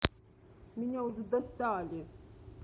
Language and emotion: Russian, angry